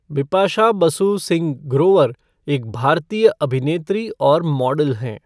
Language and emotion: Hindi, neutral